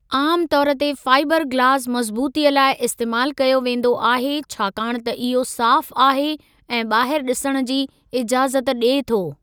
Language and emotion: Sindhi, neutral